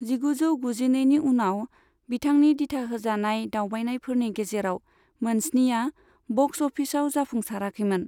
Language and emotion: Bodo, neutral